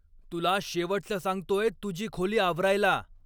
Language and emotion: Marathi, angry